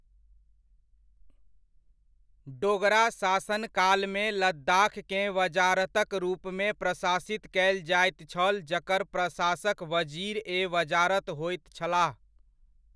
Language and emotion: Maithili, neutral